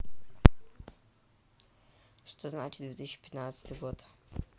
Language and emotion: Russian, neutral